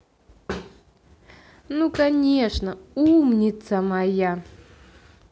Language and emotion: Russian, positive